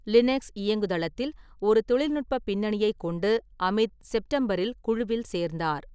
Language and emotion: Tamil, neutral